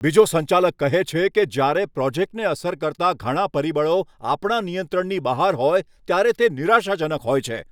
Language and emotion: Gujarati, angry